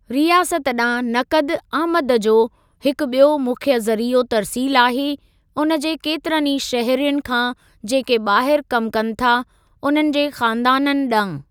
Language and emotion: Sindhi, neutral